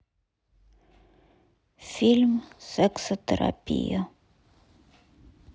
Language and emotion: Russian, sad